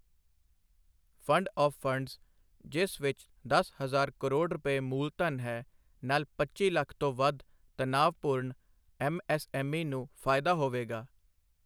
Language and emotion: Punjabi, neutral